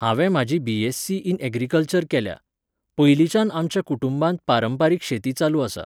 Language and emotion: Goan Konkani, neutral